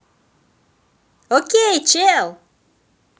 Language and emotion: Russian, positive